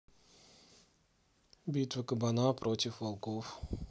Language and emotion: Russian, neutral